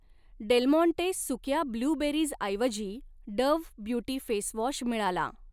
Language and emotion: Marathi, neutral